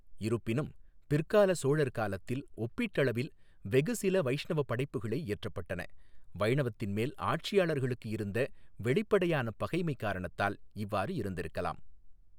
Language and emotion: Tamil, neutral